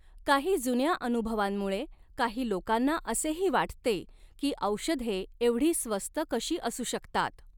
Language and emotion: Marathi, neutral